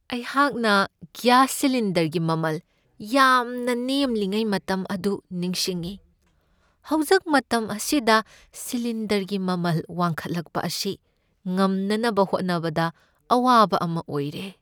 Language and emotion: Manipuri, sad